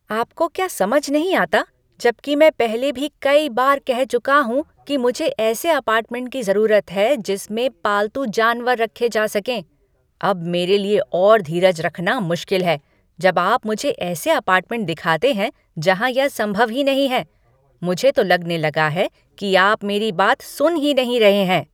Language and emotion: Hindi, angry